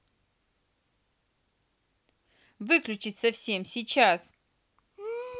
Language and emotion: Russian, angry